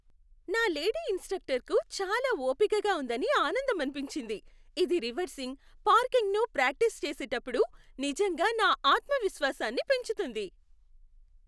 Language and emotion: Telugu, happy